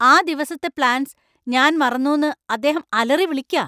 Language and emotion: Malayalam, angry